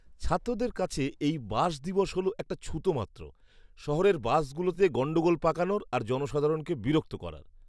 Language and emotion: Bengali, disgusted